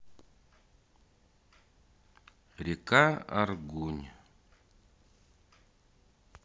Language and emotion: Russian, neutral